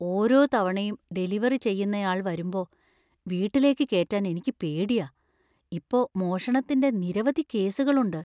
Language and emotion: Malayalam, fearful